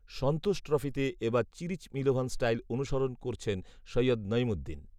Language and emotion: Bengali, neutral